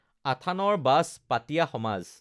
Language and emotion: Assamese, neutral